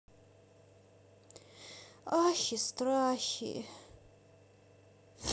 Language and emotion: Russian, sad